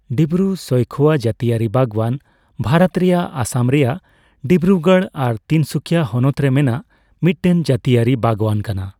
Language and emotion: Santali, neutral